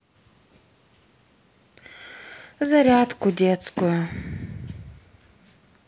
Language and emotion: Russian, sad